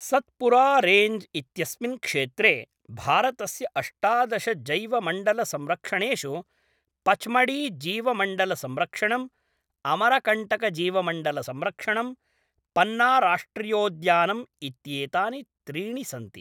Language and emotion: Sanskrit, neutral